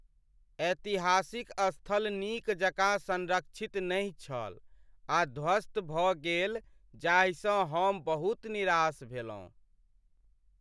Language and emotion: Maithili, sad